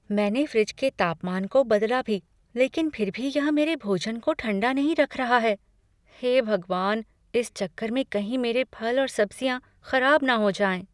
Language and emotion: Hindi, fearful